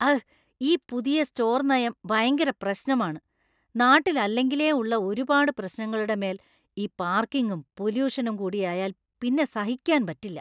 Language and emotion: Malayalam, disgusted